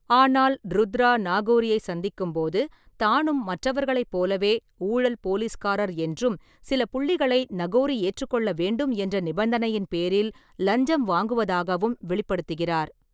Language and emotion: Tamil, neutral